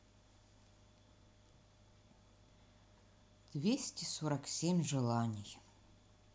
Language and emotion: Russian, sad